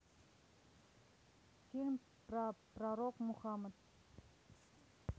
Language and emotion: Russian, neutral